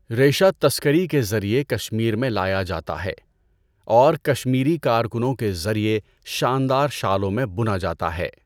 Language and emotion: Urdu, neutral